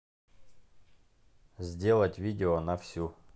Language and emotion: Russian, neutral